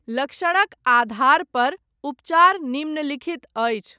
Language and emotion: Maithili, neutral